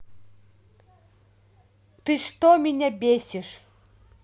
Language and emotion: Russian, angry